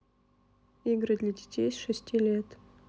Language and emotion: Russian, neutral